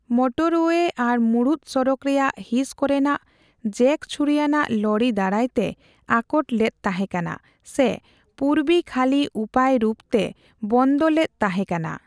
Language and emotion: Santali, neutral